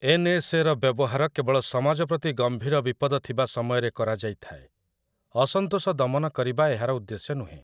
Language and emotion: Odia, neutral